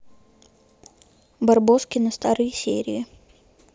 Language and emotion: Russian, neutral